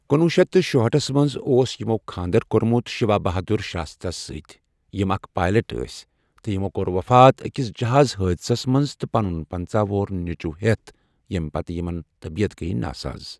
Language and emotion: Kashmiri, neutral